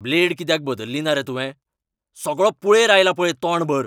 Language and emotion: Goan Konkani, angry